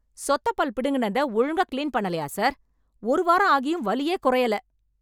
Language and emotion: Tamil, angry